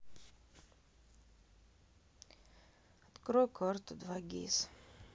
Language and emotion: Russian, sad